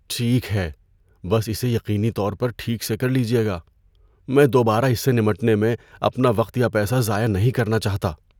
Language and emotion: Urdu, fearful